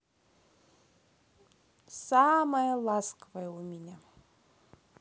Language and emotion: Russian, positive